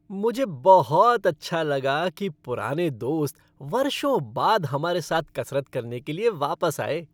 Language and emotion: Hindi, happy